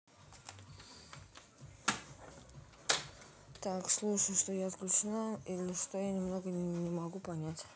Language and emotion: Russian, neutral